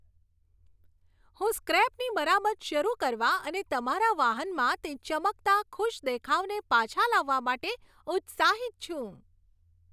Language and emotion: Gujarati, happy